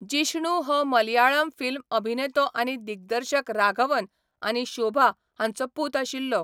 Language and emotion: Goan Konkani, neutral